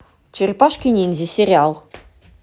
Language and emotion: Russian, positive